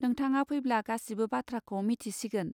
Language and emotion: Bodo, neutral